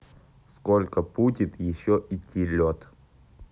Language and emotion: Russian, neutral